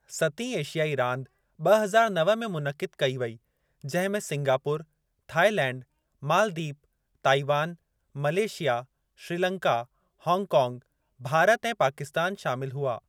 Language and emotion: Sindhi, neutral